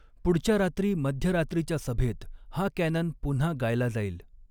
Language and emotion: Marathi, neutral